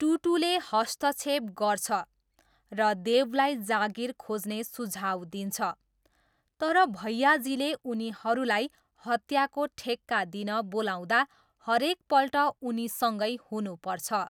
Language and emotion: Nepali, neutral